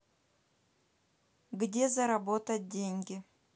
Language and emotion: Russian, neutral